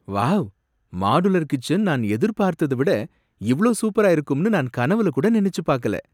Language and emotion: Tamil, surprised